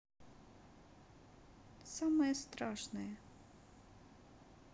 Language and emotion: Russian, sad